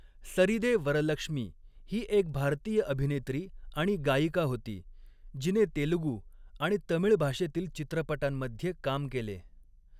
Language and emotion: Marathi, neutral